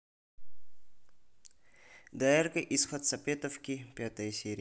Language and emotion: Russian, neutral